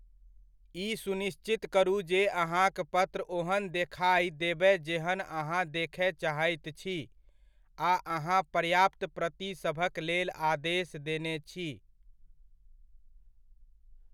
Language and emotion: Maithili, neutral